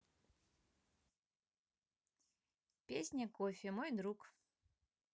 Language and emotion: Russian, neutral